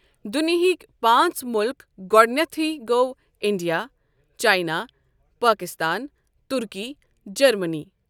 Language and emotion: Kashmiri, neutral